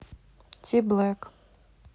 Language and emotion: Russian, neutral